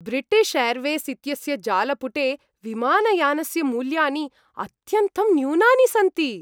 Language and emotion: Sanskrit, happy